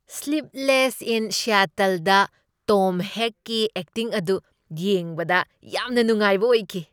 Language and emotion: Manipuri, happy